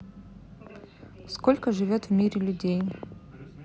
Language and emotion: Russian, neutral